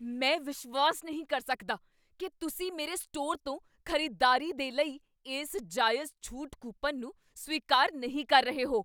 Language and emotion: Punjabi, angry